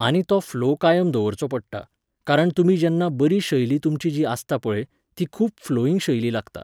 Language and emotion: Goan Konkani, neutral